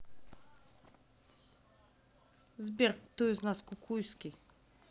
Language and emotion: Russian, neutral